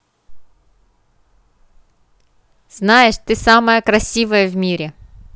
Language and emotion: Russian, positive